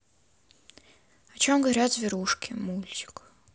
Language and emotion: Russian, sad